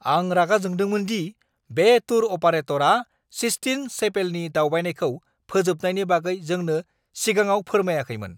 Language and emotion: Bodo, angry